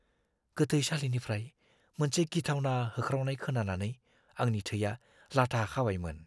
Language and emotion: Bodo, fearful